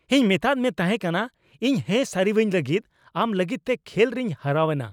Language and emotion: Santali, angry